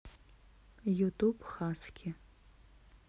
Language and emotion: Russian, neutral